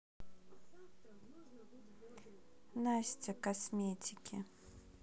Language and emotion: Russian, neutral